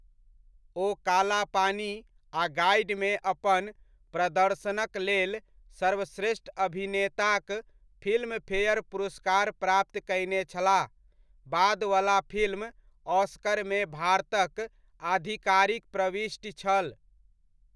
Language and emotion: Maithili, neutral